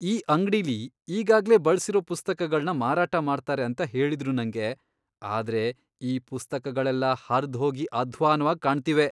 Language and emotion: Kannada, disgusted